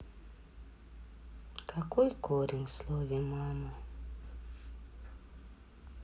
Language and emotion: Russian, sad